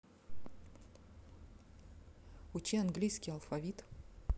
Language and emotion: Russian, neutral